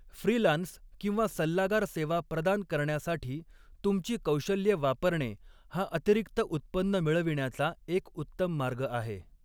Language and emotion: Marathi, neutral